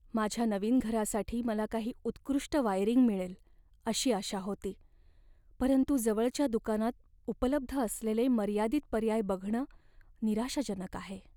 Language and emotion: Marathi, sad